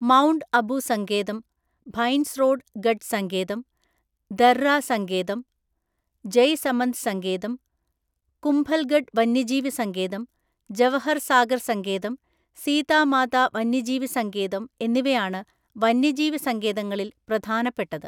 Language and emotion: Malayalam, neutral